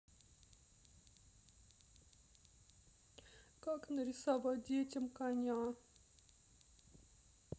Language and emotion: Russian, sad